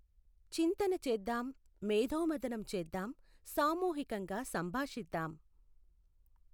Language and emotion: Telugu, neutral